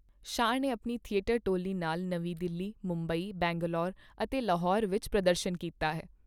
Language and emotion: Punjabi, neutral